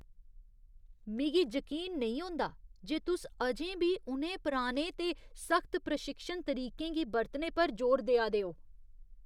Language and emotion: Dogri, disgusted